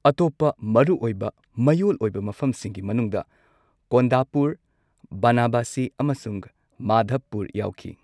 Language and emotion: Manipuri, neutral